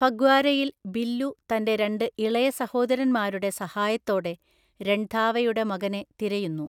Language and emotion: Malayalam, neutral